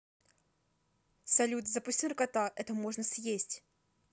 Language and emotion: Russian, neutral